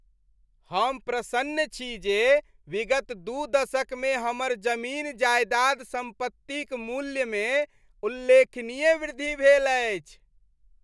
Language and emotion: Maithili, happy